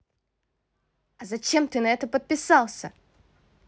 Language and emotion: Russian, angry